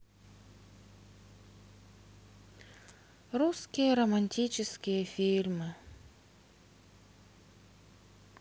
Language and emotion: Russian, sad